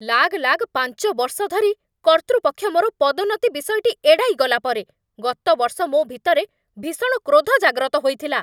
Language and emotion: Odia, angry